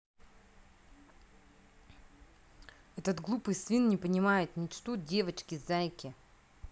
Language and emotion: Russian, angry